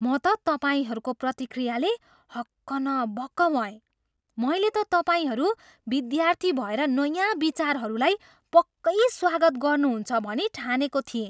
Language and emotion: Nepali, surprised